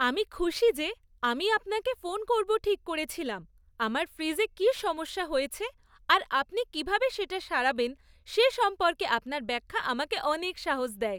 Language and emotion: Bengali, happy